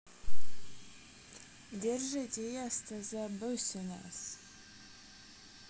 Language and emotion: Russian, neutral